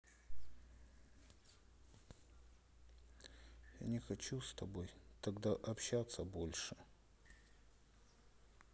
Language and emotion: Russian, sad